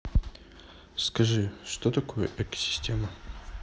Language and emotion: Russian, neutral